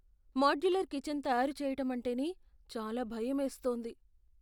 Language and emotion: Telugu, fearful